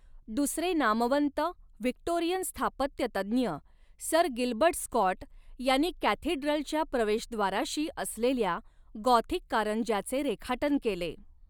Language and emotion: Marathi, neutral